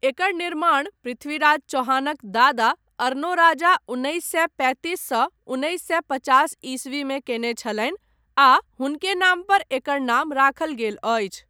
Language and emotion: Maithili, neutral